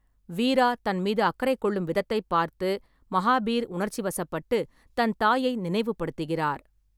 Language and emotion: Tamil, neutral